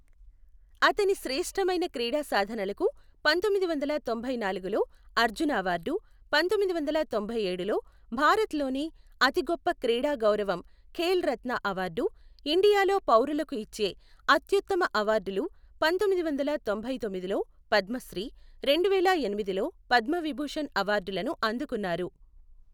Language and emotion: Telugu, neutral